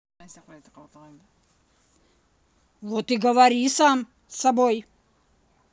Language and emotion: Russian, angry